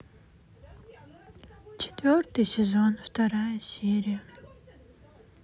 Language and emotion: Russian, sad